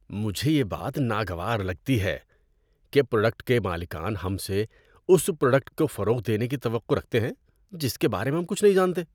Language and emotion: Urdu, disgusted